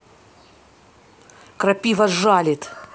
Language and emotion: Russian, angry